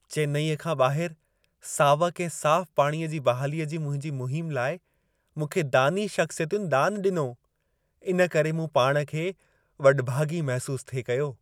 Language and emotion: Sindhi, happy